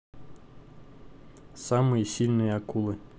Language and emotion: Russian, neutral